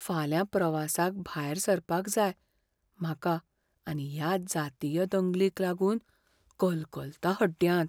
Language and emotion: Goan Konkani, fearful